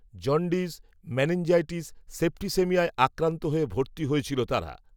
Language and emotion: Bengali, neutral